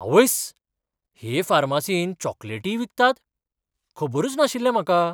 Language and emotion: Goan Konkani, surprised